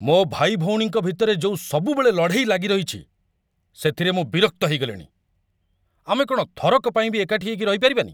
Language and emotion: Odia, angry